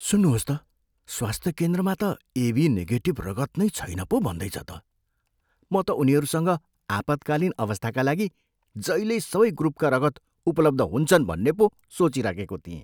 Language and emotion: Nepali, surprised